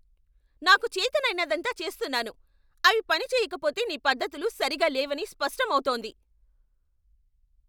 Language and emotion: Telugu, angry